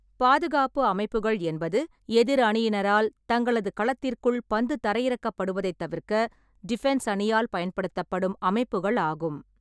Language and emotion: Tamil, neutral